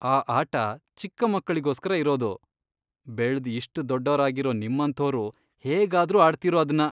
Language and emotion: Kannada, disgusted